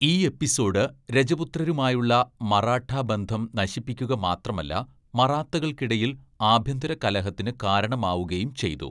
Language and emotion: Malayalam, neutral